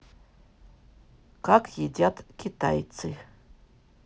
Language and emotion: Russian, neutral